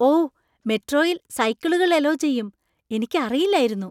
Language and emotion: Malayalam, surprised